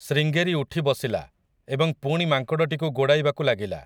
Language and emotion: Odia, neutral